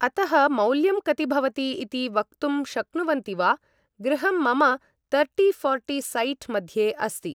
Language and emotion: Sanskrit, neutral